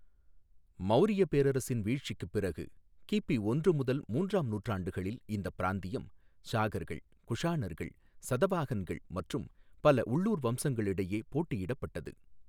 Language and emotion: Tamil, neutral